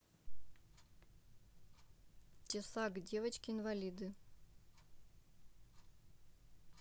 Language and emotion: Russian, neutral